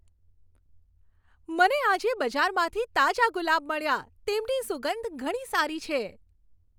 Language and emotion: Gujarati, happy